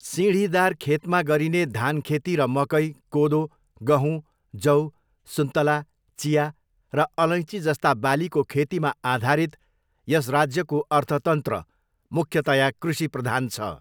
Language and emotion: Nepali, neutral